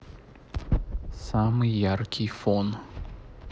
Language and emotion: Russian, neutral